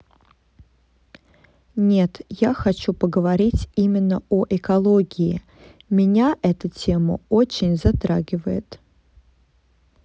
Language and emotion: Russian, neutral